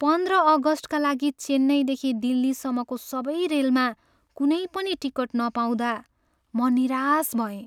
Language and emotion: Nepali, sad